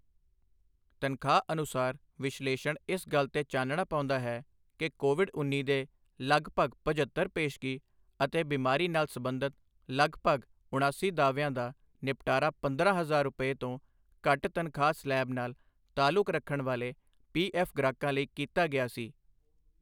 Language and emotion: Punjabi, neutral